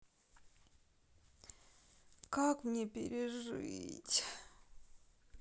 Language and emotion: Russian, sad